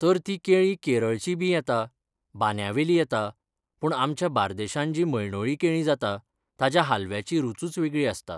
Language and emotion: Goan Konkani, neutral